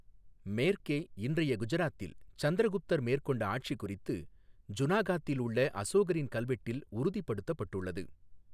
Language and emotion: Tamil, neutral